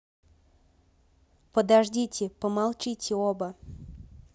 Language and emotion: Russian, neutral